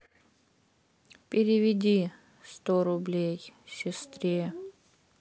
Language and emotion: Russian, sad